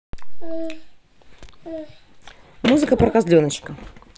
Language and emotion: Russian, neutral